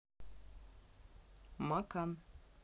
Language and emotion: Russian, neutral